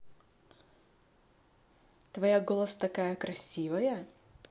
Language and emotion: Russian, positive